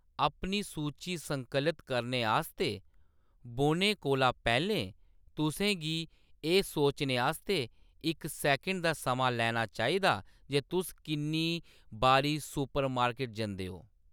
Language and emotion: Dogri, neutral